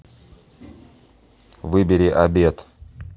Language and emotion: Russian, neutral